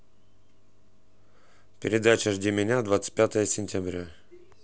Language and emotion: Russian, neutral